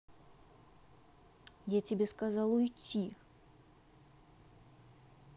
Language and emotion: Russian, angry